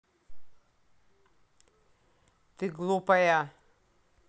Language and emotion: Russian, angry